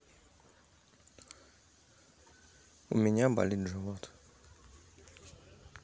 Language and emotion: Russian, neutral